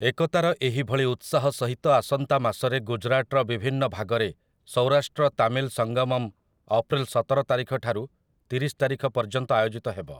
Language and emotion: Odia, neutral